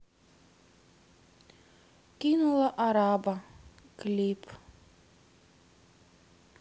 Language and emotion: Russian, sad